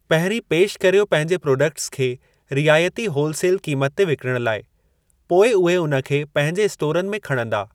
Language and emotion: Sindhi, neutral